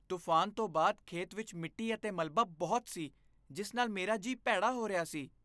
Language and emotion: Punjabi, disgusted